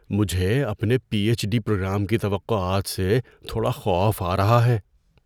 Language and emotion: Urdu, fearful